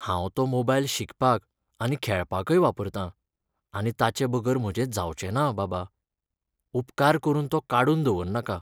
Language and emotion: Goan Konkani, sad